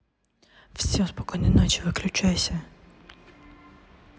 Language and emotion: Russian, neutral